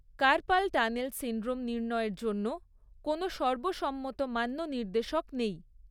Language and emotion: Bengali, neutral